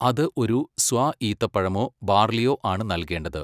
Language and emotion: Malayalam, neutral